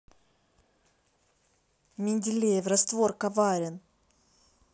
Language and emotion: Russian, neutral